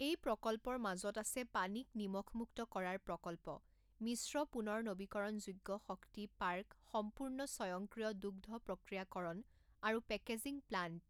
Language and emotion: Assamese, neutral